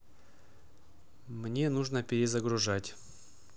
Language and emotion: Russian, neutral